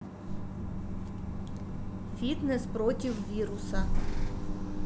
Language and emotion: Russian, neutral